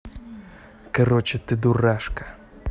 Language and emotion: Russian, angry